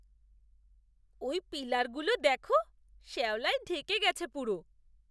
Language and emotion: Bengali, disgusted